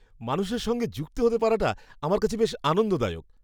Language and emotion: Bengali, happy